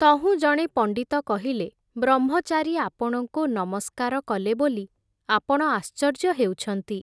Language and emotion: Odia, neutral